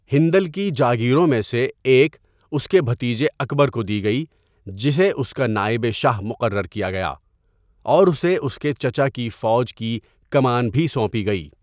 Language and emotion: Urdu, neutral